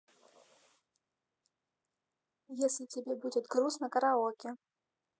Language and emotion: Russian, neutral